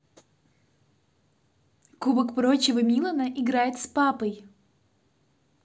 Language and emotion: Russian, positive